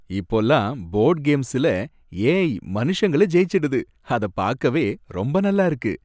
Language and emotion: Tamil, happy